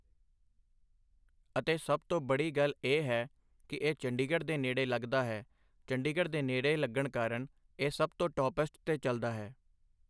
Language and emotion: Punjabi, neutral